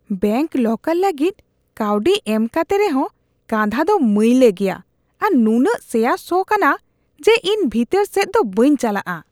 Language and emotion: Santali, disgusted